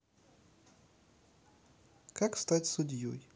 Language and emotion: Russian, neutral